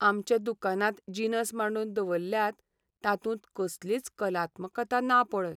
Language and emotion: Goan Konkani, sad